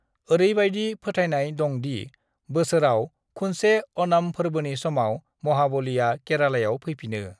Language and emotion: Bodo, neutral